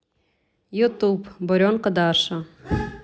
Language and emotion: Russian, neutral